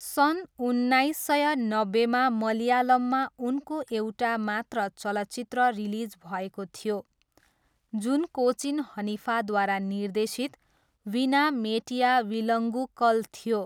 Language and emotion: Nepali, neutral